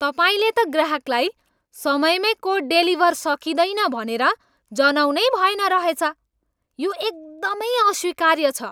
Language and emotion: Nepali, angry